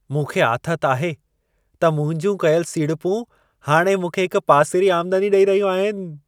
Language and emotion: Sindhi, happy